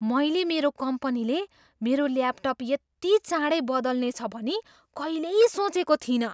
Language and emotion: Nepali, surprised